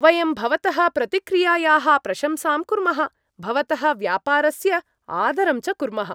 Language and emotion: Sanskrit, happy